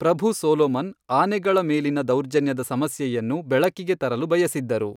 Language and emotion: Kannada, neutral